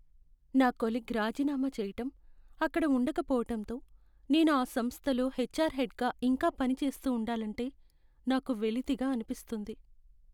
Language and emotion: Telugu, sad